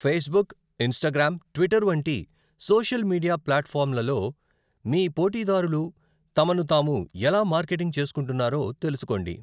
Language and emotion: Telugu, neutral